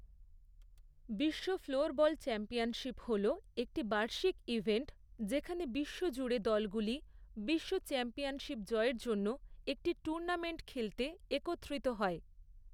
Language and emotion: Bengali, neutral